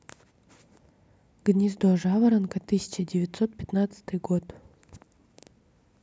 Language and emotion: Russian, neutral